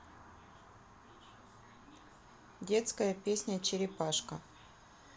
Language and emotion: Russian, neutral